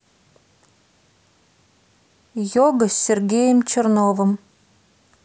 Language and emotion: Russian, neutral